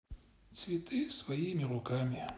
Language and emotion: Russian, sad